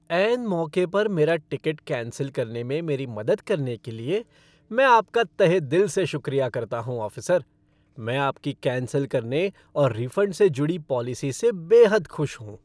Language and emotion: Hindi, happy